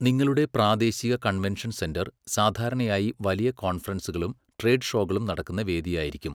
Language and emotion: Malayalam, neutral